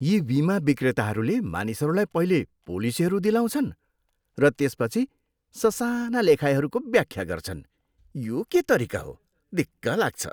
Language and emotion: Nepali, disgusted